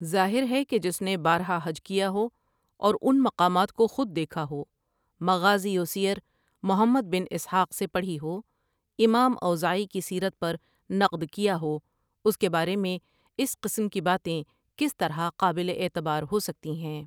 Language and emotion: Urdu, neutral